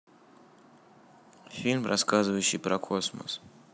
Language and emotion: Russian, neutral